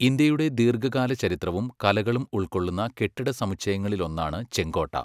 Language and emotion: Malayalam, neutral